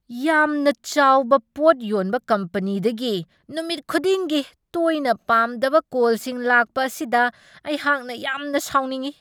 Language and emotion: Manipuri, angry